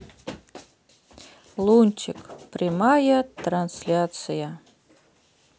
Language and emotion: Russian, neutral